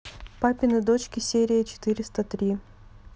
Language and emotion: Russian, neutral